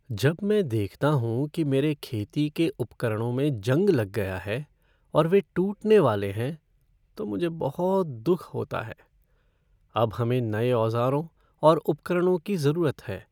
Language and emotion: Hindi, sad